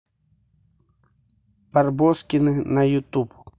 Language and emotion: Russian, neutral